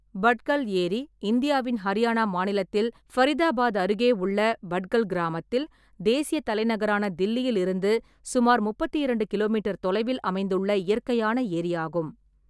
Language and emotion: Tamil, neutral